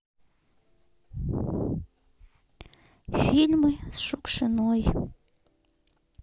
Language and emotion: Russian, sad